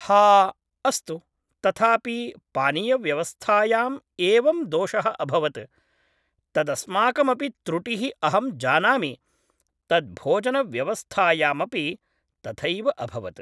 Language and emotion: Sanskrit, neutral